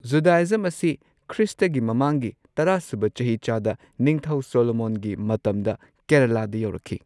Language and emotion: Manipuri, neutral